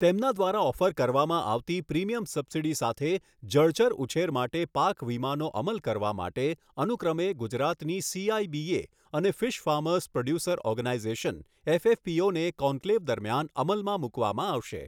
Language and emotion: Gujarati, neutral